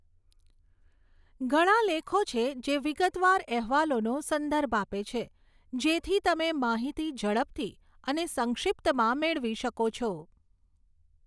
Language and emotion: Gujarati, neutral